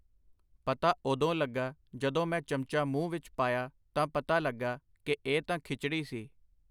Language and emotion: Punjabi, neutral